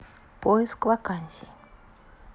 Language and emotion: Russian, neutral